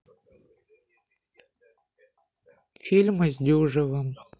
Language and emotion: Russian, sad